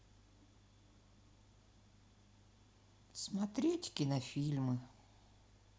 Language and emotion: Russian, sad